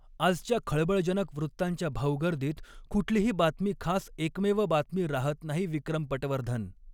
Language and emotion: Marathi, neutral